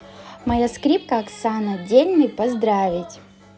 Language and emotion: Russian, positive